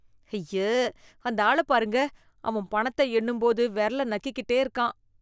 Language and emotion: Tamil, disgusted